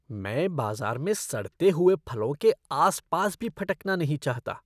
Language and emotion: Hindi, disgusted